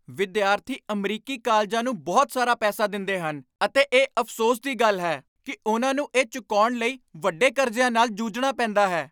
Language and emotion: Punjabi, angry